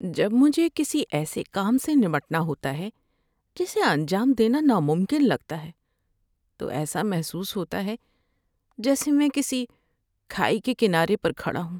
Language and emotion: Urdu, sad